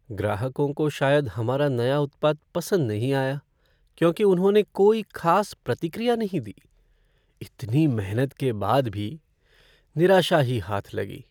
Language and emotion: Hindi, sad